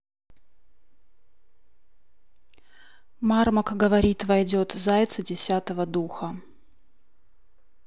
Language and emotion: Russian, neutral